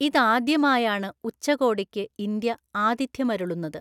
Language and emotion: Malayalam, neutral